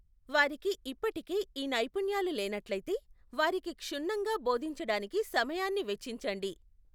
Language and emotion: Telugu, neutral